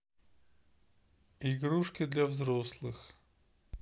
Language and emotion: Russian, neutral